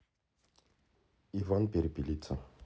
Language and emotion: Russian, neutral